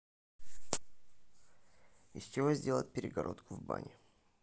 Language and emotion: Russian, neutral